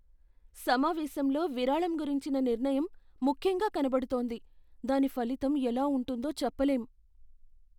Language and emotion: Telugu, fearful